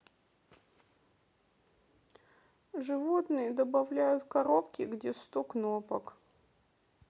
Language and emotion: Russian, sad